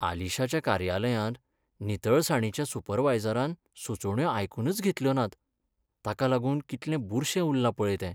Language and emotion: Goan Konkani, sad